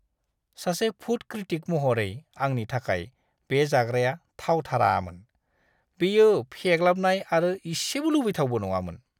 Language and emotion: Bodo, disgusted